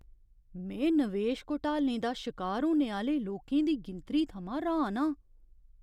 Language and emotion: Dogri, surprised